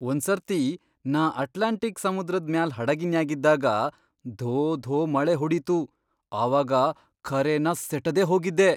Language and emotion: Kannada, surprised